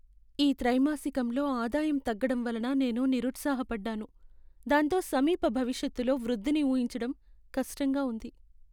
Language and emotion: Telugu, sad